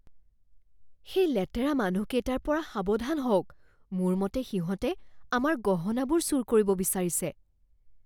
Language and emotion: Assamese, fearful